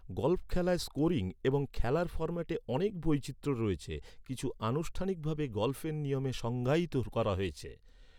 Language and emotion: Bengali, neutral